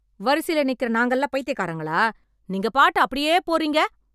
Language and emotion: Tamil, angry